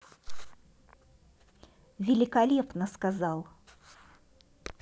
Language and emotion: Russian, positive